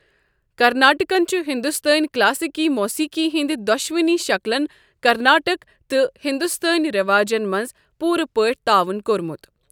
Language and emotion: Kashmiri, neutral